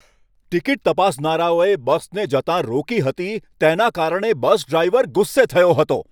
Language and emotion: Gujarati, angry